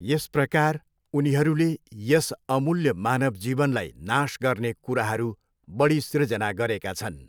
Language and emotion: Nepali, neutral